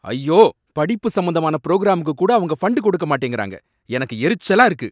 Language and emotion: Tamil, angry